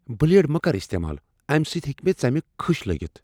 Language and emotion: Kashmiri, fearful